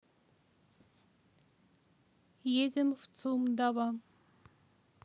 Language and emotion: Russian, neutral